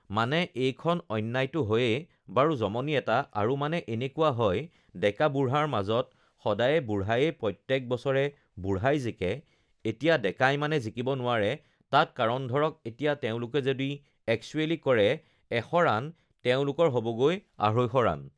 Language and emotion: Assamese, neutral